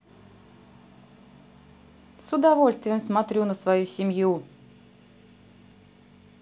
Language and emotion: Russian, positive